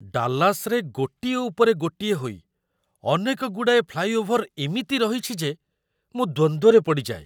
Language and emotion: Odia, surprised